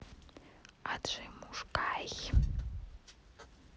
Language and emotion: Russian, neutral